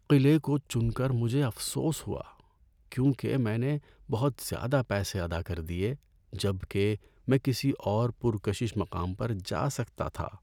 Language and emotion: Urdu, sad